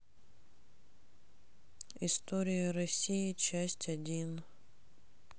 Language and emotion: Russian, sad